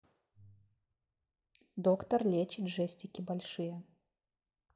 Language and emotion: Russian, neutral